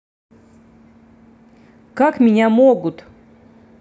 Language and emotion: Russian, angry